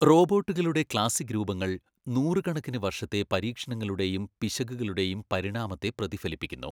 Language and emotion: Malayalam, neutral